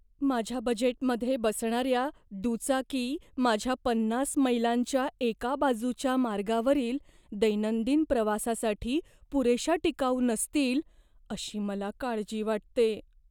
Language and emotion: Marathi, fearful